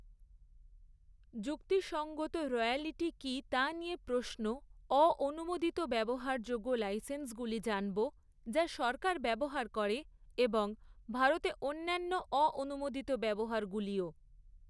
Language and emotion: Bengali, neutral